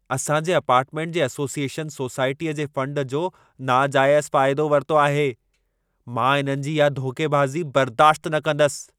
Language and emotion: Sindhi, angry